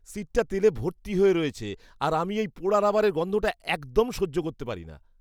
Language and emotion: Bengali, disgusted